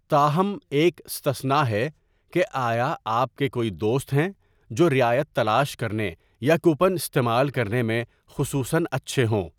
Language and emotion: Urdu, neutral